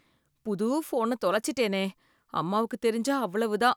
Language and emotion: Tamil, fearful